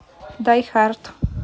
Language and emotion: Russian, neutral